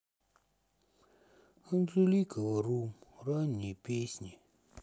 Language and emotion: Russian, sad